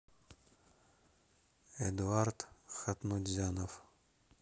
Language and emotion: Russian, neutral